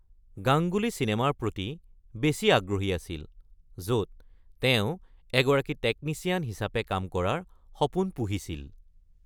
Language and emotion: Assamese, neutral